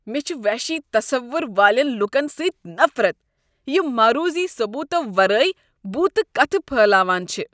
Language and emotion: Kashmiri, disgusted